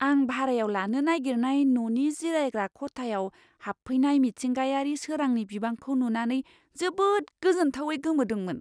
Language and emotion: Bodo, surprised